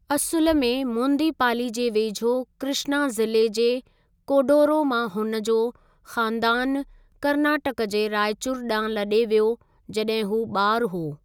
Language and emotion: Sindhi, neutral